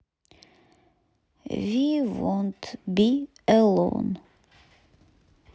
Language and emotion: Russian, neutral